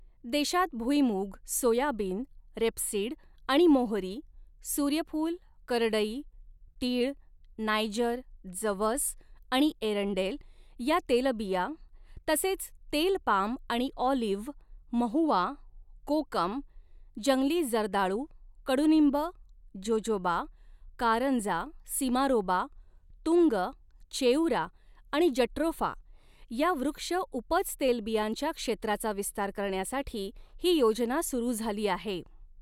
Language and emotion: Marathi, neutral